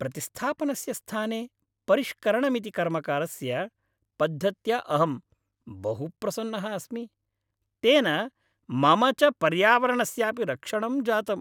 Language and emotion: Sanskrit, happy